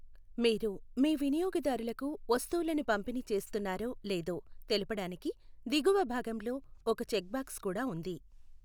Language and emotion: Telugu, neutral